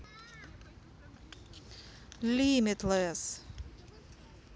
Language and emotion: Russian, neutral